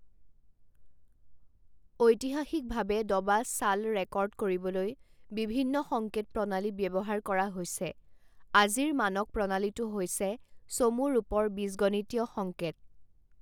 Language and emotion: Assamese, neutral